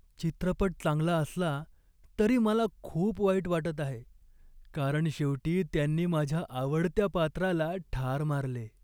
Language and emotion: Marathi, sad